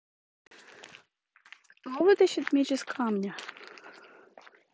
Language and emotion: Russian, neutral